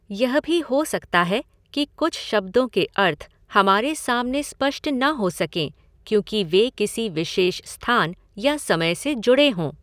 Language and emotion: Hindi, neutral